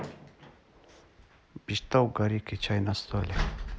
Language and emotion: Russian, neutral